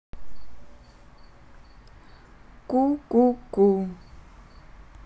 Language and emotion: Russian, neutral